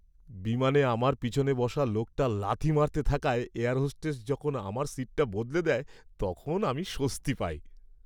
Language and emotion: Bengali, happy